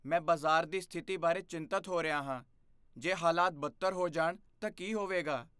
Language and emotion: Punjabi, fearful